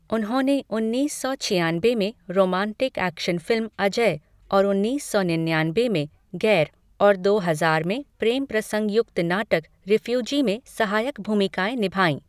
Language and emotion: Hindi, neutral